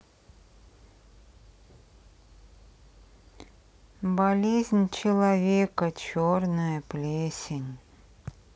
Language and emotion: Russian, sad